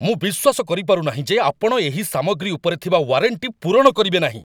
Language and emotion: Odia, angry